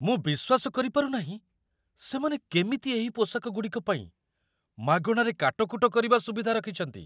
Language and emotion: Odia, surprised